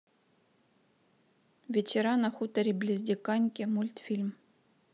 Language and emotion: Russian, neutral